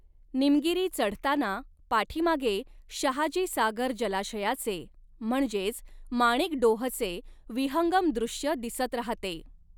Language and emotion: Marathi, neutral